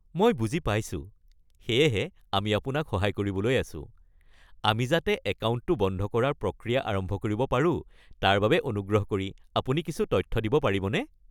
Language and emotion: Assamese, happy